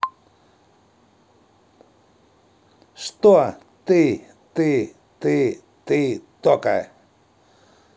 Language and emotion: Russian, angry